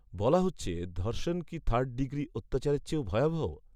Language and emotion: Bengali, neutral